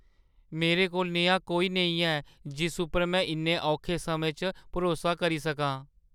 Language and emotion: Dogri, sad